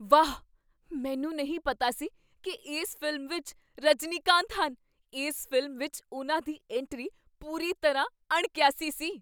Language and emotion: Punjabi, surprised